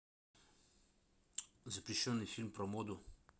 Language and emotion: Russian, neutral